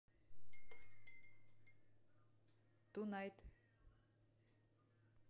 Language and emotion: Russian, neutral